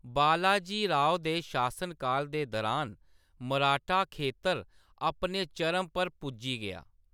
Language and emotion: Dogri, neutral